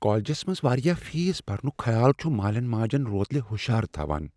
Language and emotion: Kashmiri, fearful